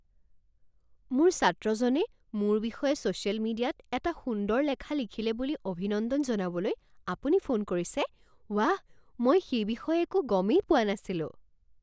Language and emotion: Assamese, surprised